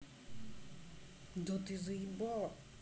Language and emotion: Russian, angry